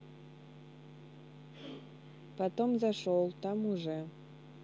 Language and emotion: Russian, neutral